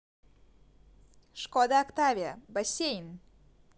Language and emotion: Russian, positive